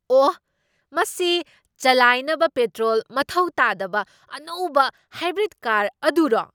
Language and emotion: Manipuri, surprised